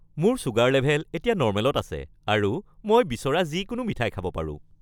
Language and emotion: Assamese, happy